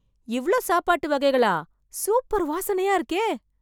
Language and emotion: Tamil, surprised